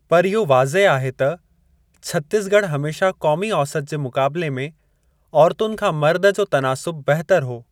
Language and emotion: Sindhi, neutral